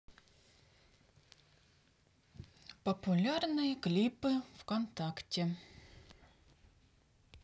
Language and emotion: Russian, neutral